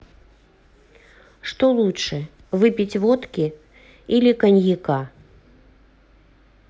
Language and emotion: Russian, neutral